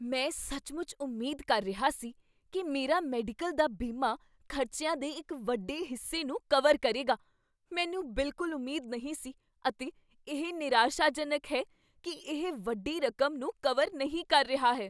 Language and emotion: Punjabi, surprised